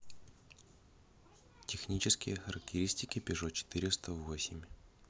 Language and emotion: Russian, neutral